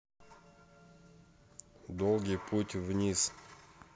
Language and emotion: Russian, neutral